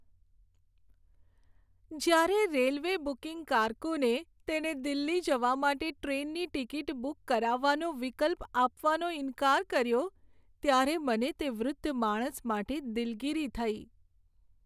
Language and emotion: Gujarati, sad